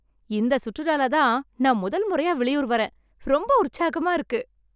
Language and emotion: Tamil, happy